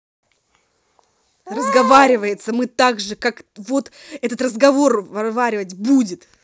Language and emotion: Russian, angry